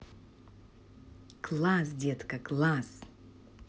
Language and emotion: Russian, positive